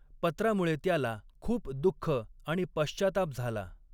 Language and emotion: Marathi, neutral